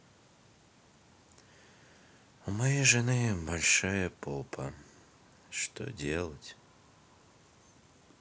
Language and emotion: Russian, sad